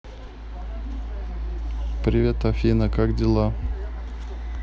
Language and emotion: Russian, neutral